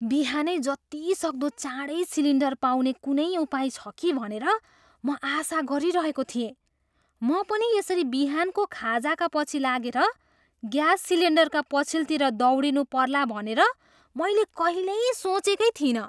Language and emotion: Nepali, surprised